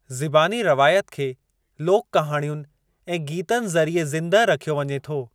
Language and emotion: Sindhi, neutral